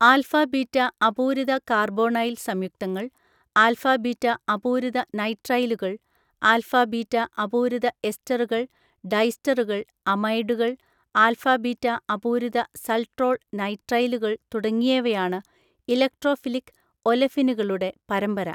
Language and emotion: Malayalam, neutral